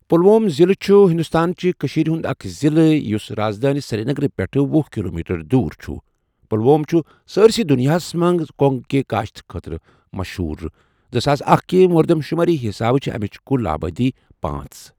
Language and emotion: Kashmiri, neutral